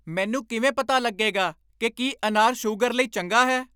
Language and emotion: Punjabi, angry